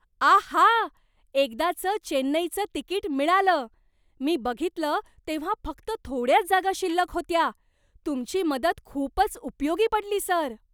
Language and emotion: Marathi, surprised